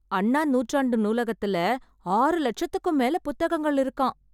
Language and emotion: Tamil, surprised